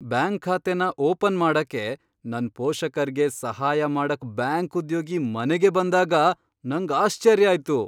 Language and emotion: Kannada, surprised